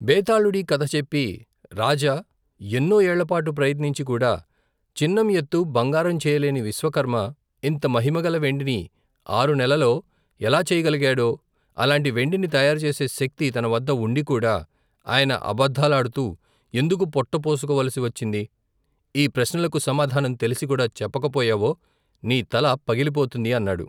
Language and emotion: Telugu, neutral